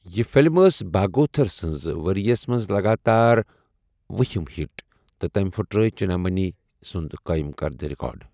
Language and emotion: Kashmiri, neutral